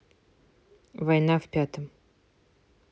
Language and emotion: Russian, neutral